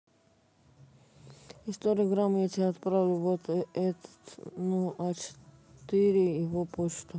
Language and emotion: Russian, neutral